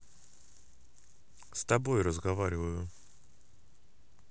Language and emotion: Russian, neutral